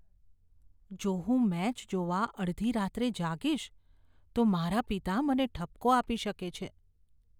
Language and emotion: Gujarati, fearful